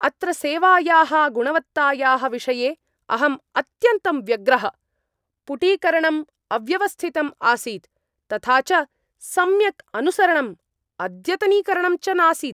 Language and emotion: Sanskrit, angry